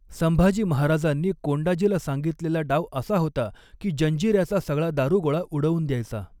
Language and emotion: Marathi, neutral